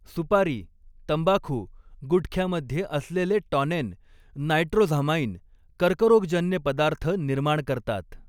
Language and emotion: Marathi, neutral